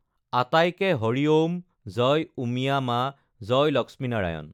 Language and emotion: Assamese, neutral